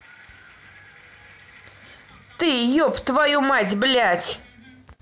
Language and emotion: Russian, angry